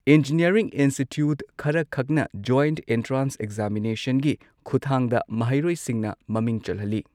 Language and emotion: Manipuri, neutral